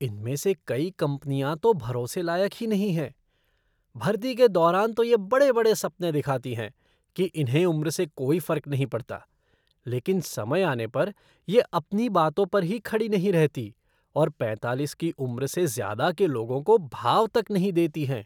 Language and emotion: Hindi, disgusted